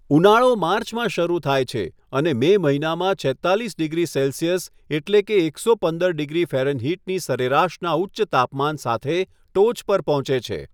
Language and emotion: Gujarati, neutral